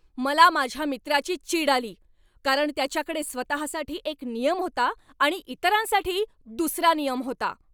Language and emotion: Marathi, angry